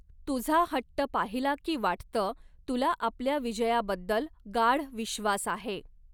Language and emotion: Marathi, neutral